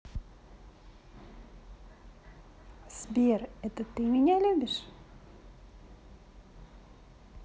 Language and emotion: Russian, positive